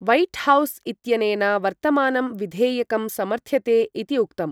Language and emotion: Sanskrit, neutral